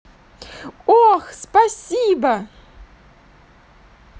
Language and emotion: Russian, positive